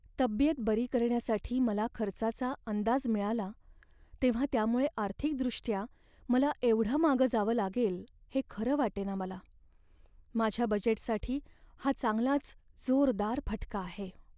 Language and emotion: Marathi, sad